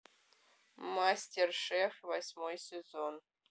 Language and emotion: Russian, neutral